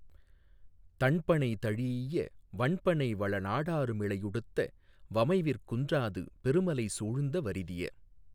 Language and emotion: Tamil, neutral